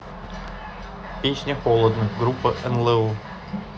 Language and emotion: Russian, neutral